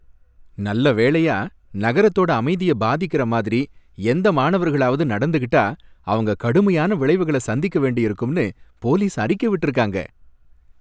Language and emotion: Tamil, happy